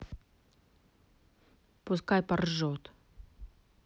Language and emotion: Russian, angry